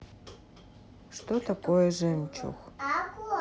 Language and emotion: Russian, neutral